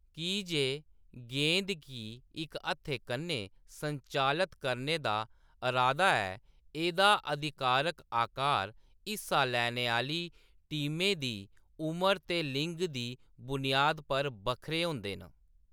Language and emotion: Dogri, neutral